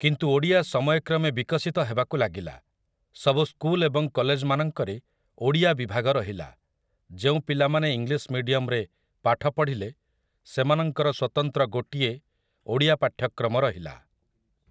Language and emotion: Odia, neutral